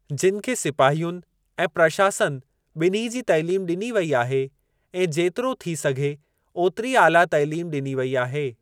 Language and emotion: Sindhi, neutral